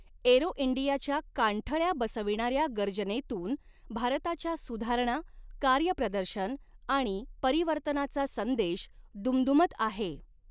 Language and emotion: Marathi, neutral